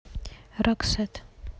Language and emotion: Russian, neutral